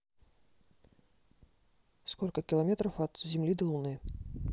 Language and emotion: Russian, neutral